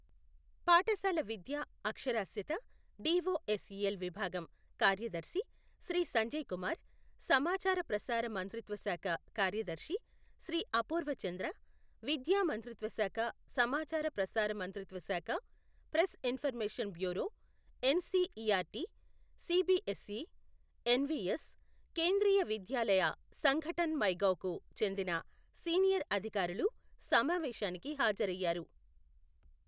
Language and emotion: Telugu, neutral